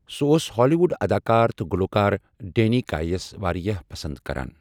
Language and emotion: Kashmiri, neutral